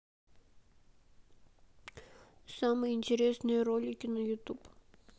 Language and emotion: Russian, sad